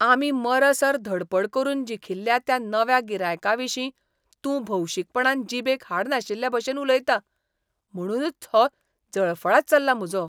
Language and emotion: Goan Konkani, disgusted